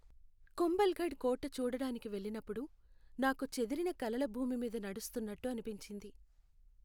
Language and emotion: Telugu, sad